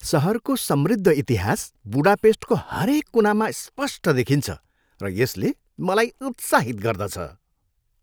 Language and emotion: Nepali, happy